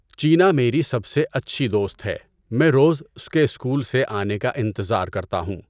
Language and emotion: Urdu, neutral